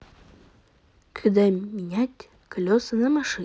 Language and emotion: Russian, neutral